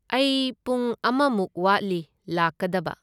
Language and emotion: Manipuri, neutral